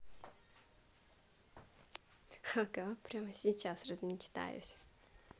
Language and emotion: Russian, positive